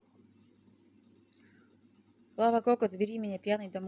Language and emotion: Russian, neutral